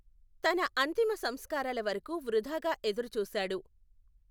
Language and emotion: Telugu, neutral